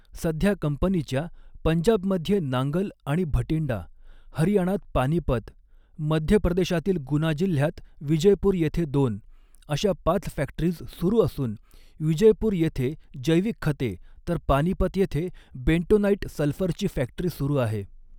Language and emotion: Marathi, neutral